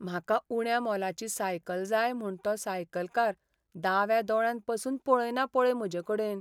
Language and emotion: Goan Konkani, sad